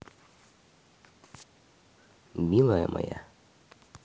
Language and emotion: Russian, positive